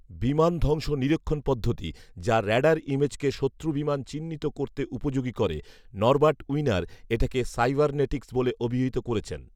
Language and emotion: Bengali, neutral